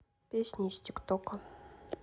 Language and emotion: Russian, neutral